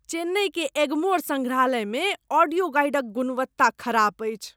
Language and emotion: Maithili, disgusted